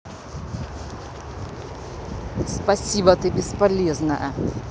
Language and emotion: Russian, angry